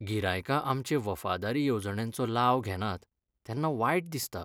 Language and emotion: Goan Konkani, sad